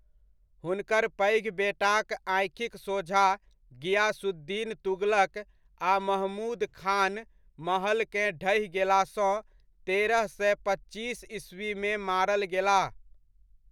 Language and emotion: Maithili, neutral